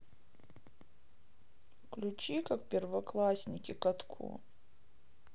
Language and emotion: Russian, sad